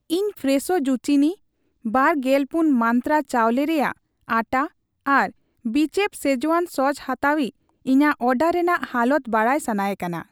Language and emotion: Santali, neutral